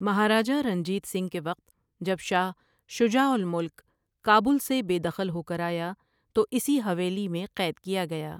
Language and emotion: Urdu, neutral